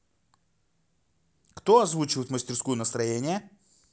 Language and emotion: Russian, positive